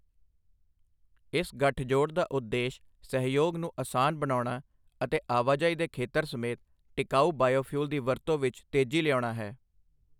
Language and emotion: Punjabi, neutral